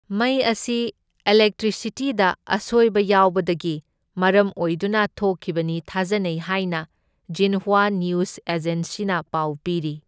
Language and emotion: Manipuri, neutral